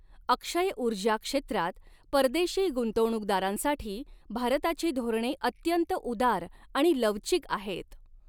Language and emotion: Marathi, neutral